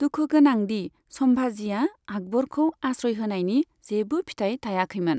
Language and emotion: Bodo, neutral